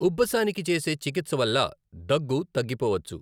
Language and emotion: Telugu, neutral